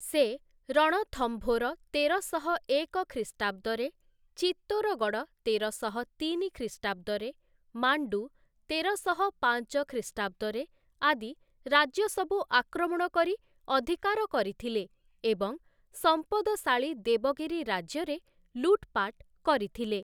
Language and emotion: Odia, neutral